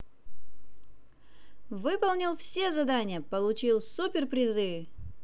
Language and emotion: Russian, positive